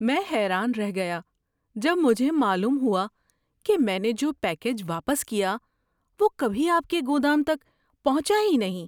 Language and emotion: Urdu, surprised